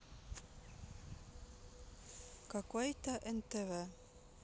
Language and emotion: Russian, neutral